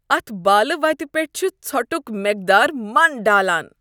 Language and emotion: Kashmiri, disgusted